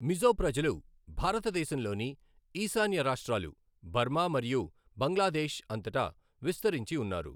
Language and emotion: Telugu, neutral